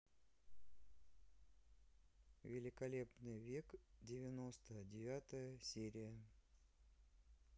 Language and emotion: Russian, neutral